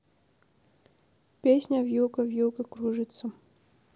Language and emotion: Russian, neutral